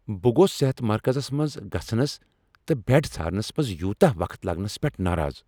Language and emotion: Kashmiri, angry